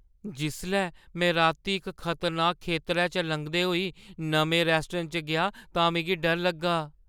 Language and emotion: Dogri, fearful